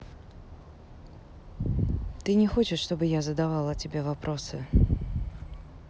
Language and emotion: Russian, neutral